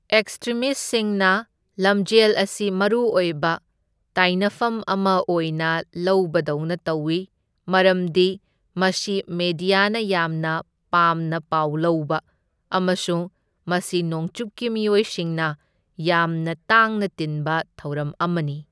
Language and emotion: Manipuri, neutral